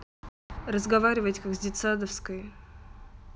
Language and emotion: Russian, neutral